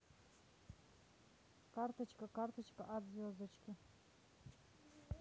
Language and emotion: Russian, neutral